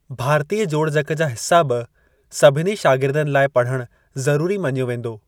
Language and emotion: Sindhi, neutral